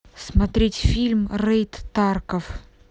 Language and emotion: Russian, neutral